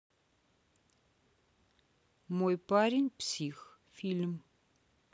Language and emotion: Russian, neutral